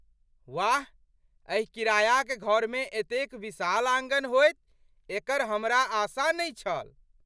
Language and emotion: Maithili, surprised